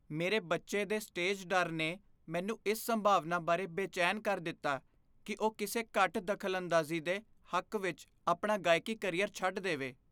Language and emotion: Punjabi, fearful